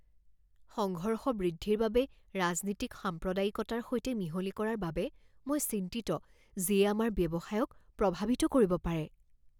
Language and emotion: Assamese, fearful